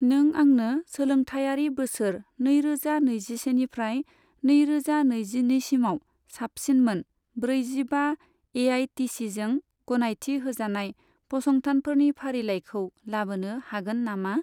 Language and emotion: Bodo, neutral